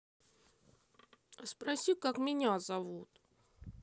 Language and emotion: Russian, sad